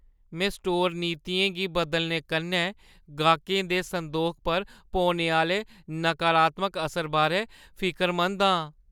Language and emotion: Dogri, fearful